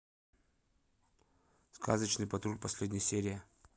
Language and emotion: Russian, neutral